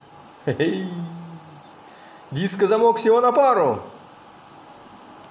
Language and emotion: Russian, positive